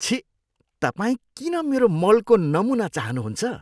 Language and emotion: Nepali, disgusted